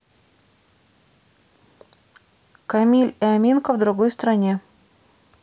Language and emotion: Russian, neutral